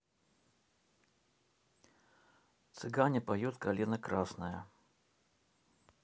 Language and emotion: Russian, neutral